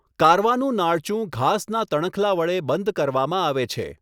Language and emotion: Gujarati, neutral